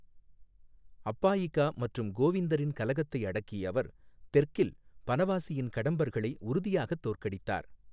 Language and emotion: Tamil, neutral